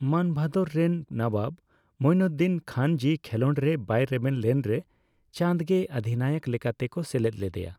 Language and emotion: Santali, neutral